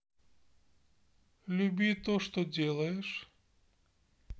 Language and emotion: Russian, neutral